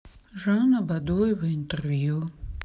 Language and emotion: Russian, sad